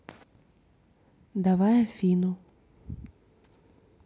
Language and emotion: Russian, neutral